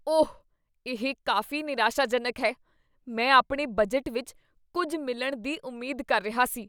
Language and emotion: Punjabi, disgusted